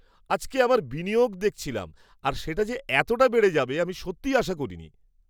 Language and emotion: Bengali, surprised